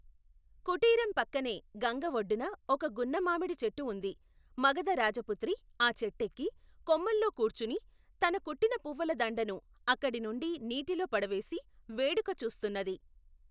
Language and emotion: Telugu, neutral